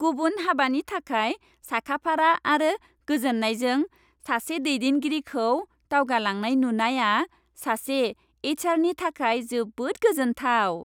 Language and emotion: Bodo, happy